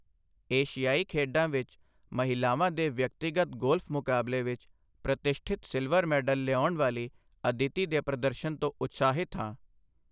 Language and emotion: Punjabi, neutral